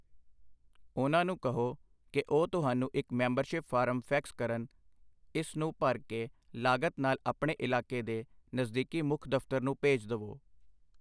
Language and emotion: Punjabi, neutral